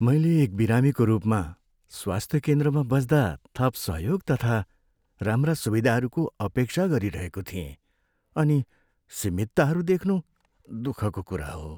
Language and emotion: Nepali, sad